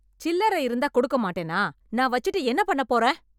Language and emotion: Tamil, angry